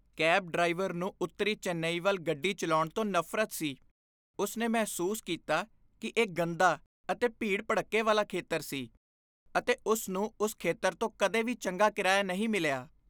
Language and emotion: Punjabi, disgusted